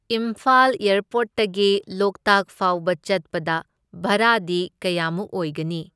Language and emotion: Manipuri, neutral